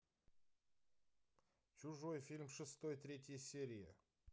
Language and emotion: Russian, neutral